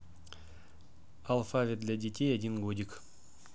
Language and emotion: Russian, neutral